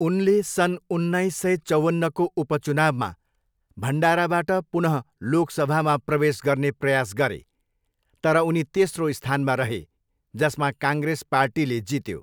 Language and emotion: Nepali, neutral